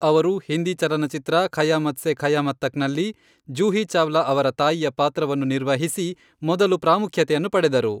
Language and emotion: Kannada, neutral